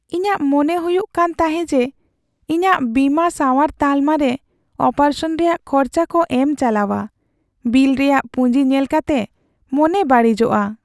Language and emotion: Santali, sad